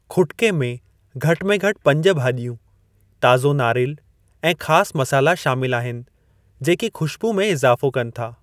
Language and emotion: Sindhi, neutral